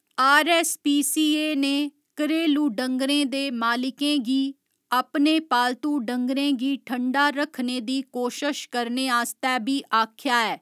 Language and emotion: Dogri, neutral